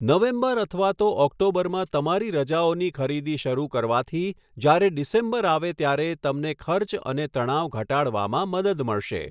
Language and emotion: Gujarati, neutral